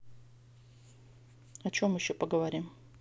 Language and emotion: Russian, neutral